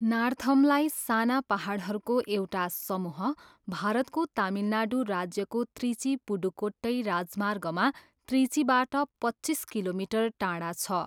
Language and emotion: Nepali, neutral